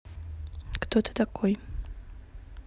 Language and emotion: Russian, neutral